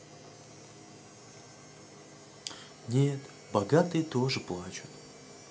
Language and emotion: Russian, sad